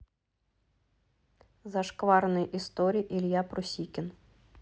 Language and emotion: Russian, neutral